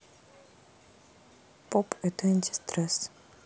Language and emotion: Russian, sad